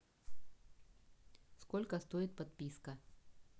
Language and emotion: Russian, neutral